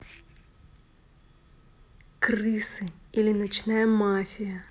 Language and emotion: Russian, neutral